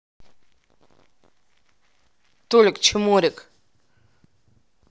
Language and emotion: Russian, neutral